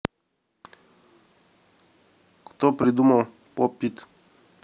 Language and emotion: Russian, neutral